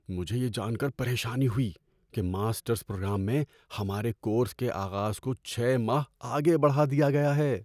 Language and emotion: Urdu, fearful